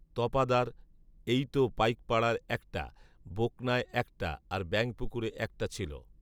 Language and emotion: Bengali, neutral